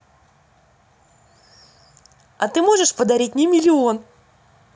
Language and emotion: Russian, positive